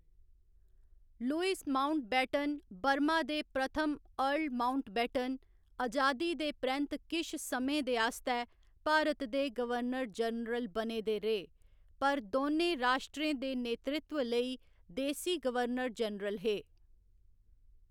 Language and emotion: Dogri, neutral